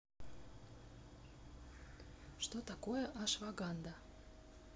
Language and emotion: Russian, neutral